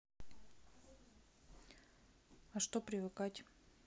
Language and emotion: Russian, neutral